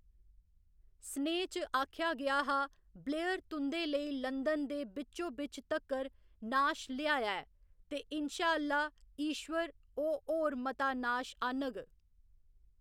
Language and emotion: Dogri, neutral